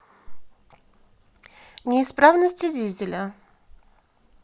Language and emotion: Russian, neutral